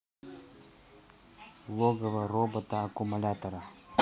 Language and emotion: Russian, neutral